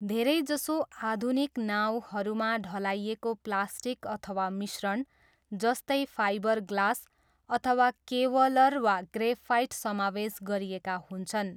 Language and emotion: Nepali, neutral